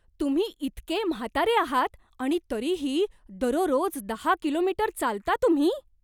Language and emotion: Marathi, surprised